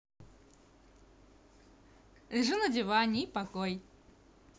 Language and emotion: Russian, positive